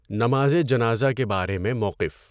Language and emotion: Urdu, neutral